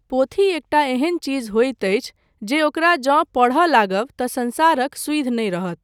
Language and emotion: Maithili, neutral